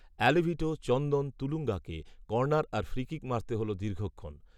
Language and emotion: Bengali, neutral